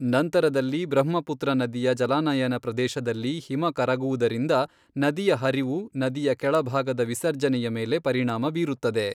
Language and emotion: Kannada, neutral